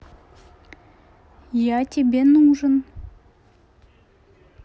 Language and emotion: Russian, neutral